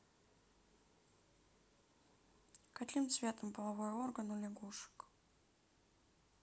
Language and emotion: Russian, neutral